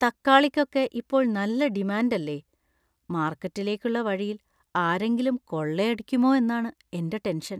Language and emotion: Malayalam, fearful